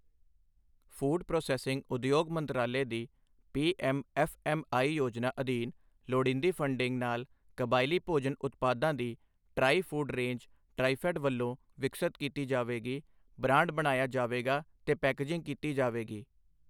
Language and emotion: Punjabi, neutral